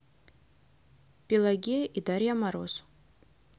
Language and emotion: Russian, neutral